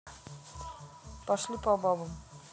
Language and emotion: Russian, neutral